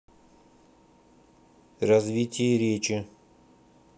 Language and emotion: Russian, neutral